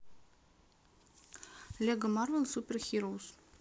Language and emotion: Russian, neutral